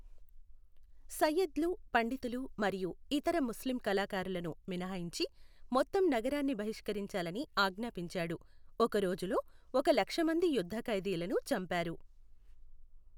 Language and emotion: Telugu, neutral